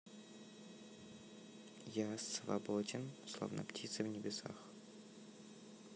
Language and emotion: Russian, neutral